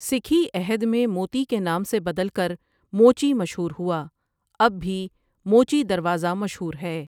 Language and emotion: Urdu, neutral